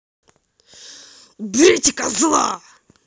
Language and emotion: Russian, angry